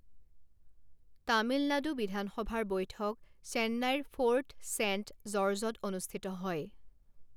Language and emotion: Assamese, neutral